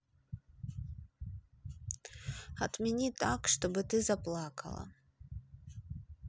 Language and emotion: Russian, neutral